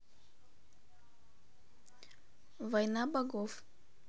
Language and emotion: Russian, neutral